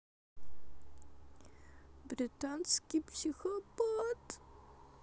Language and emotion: Russian, sad